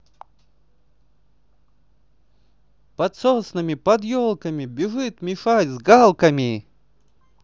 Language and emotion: Russian, positive